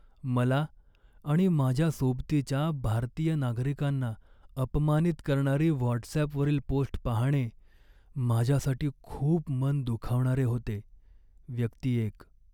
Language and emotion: Marathi, sad